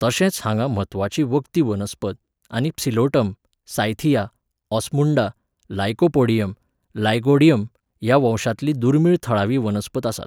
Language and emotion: Goan Konkani, neutral